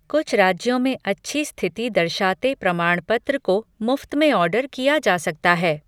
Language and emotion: Hindi, neutral